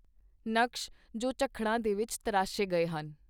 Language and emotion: Punjabi, neutral